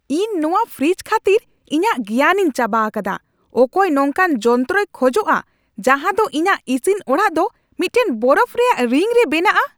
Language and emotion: Santali, angry